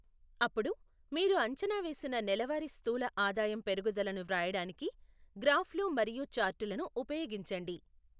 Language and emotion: Telugu, neutral